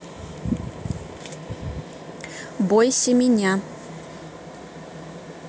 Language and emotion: Russian, neutral